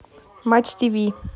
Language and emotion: Russian, neutral